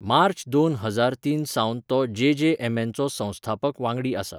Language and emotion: Goan Konkani, neutral